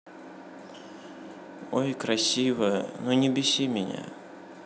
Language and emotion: Russian, sad